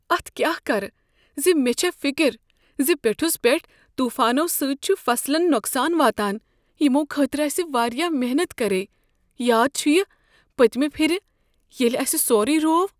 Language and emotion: Kashmiri, fearful